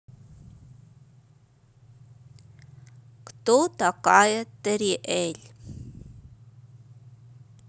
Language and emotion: Russian, neutral